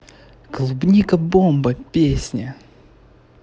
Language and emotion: Russian, positive